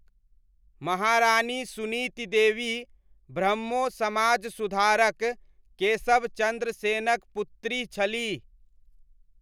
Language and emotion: Maithili, neutral